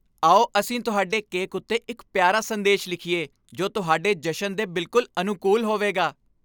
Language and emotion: Punjabi, happy